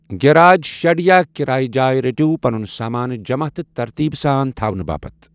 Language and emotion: Kashmiri, neutral